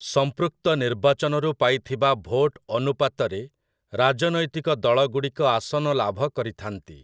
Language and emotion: Odia, neutral